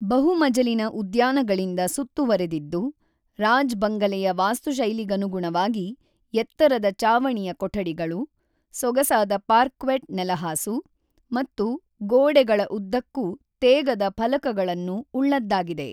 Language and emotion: Kannada, neutral